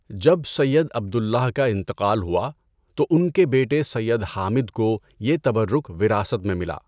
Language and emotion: Urdu, neutral